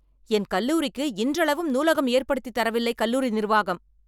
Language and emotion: Tamil, angry